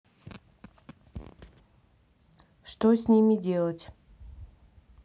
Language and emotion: Russian, neutral